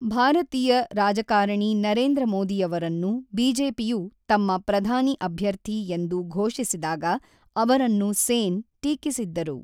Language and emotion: Kannada, neutral